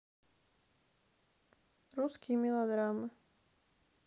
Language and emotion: Russian, sad